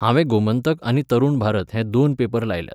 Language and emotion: Goan Konkani, neutral